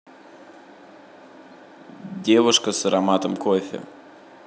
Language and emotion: Russian, neutral